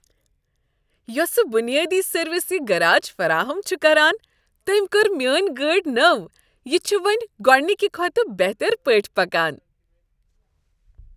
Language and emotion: Kashmiri, happy